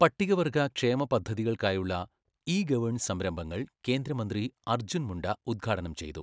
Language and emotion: Malayalam, neutral